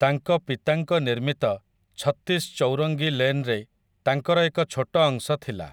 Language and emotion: Odia, neutral